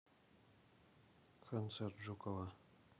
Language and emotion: Russian, neutral